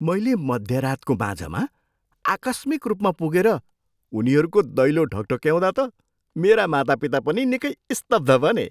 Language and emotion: Nepali, surprised